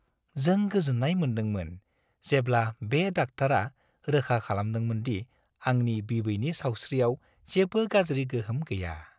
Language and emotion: Bodo, happy